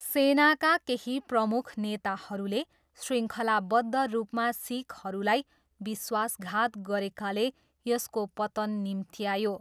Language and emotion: Nepali, neutral